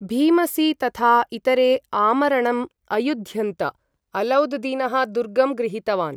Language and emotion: Sanskrit, neutral